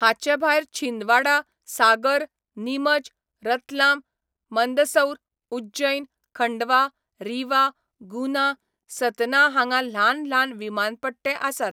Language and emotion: Goan Konkani, neutral